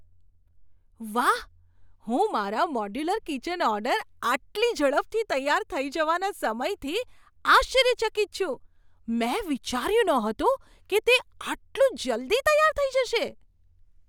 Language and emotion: Gujarati, surprised